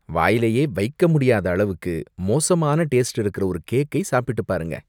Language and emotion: Tamil, disgusted